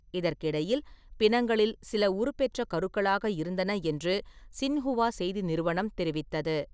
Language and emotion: Tamil, neutral